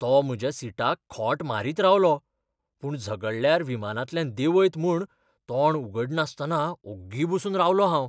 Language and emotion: Goan Konkani, fearful